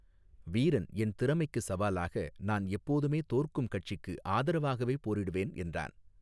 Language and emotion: Tamil, neutral